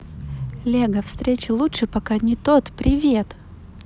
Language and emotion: Russian, positive